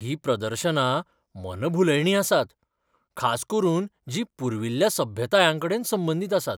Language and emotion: Goan Konkani, surprised